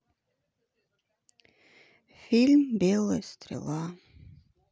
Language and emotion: Russian, sad